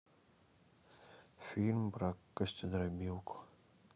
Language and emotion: Russian, neutral